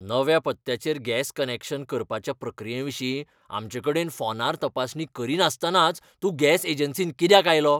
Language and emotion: Goan Konkani, angry